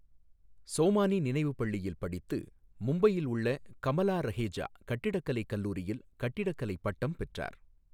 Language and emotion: Tamil, neutral